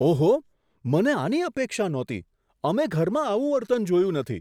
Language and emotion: Gujarati, surprised